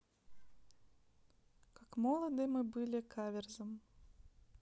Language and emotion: Russian, neutral